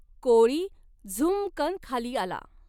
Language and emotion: Marathi, neutral